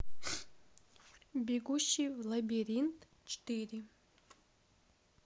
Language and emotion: Russian, neutral